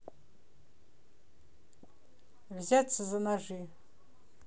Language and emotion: Russian, neutral